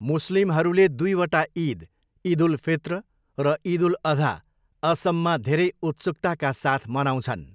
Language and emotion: Nepali, neutral